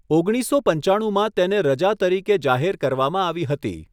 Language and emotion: Gujarati, neutral